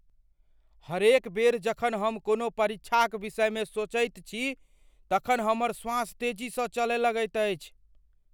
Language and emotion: Maithili, fearful